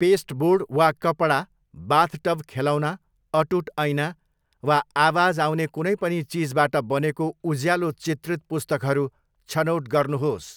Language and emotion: Nepali, neutral